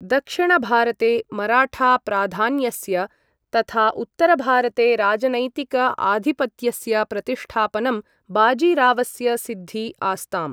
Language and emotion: Sanskrit, neutral